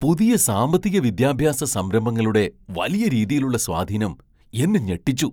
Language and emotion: Malayalam, surprised